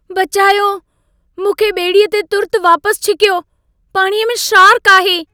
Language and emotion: Sindhi, fearful